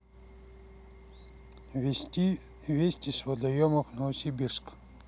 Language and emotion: Russian, neutral